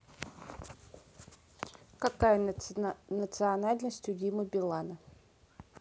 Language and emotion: Russian, neutral